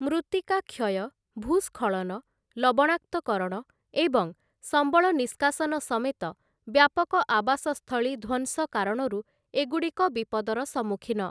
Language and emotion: Odia, neutral